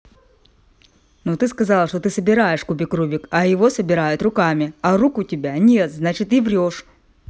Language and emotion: Russian, angry